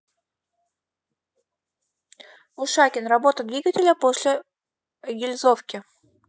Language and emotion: Russian, neutral